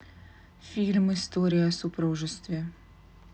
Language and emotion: Russian, neutral